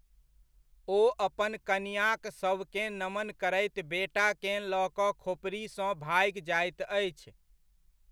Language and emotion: Maithili, neutral